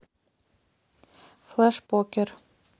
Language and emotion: Russian, neutral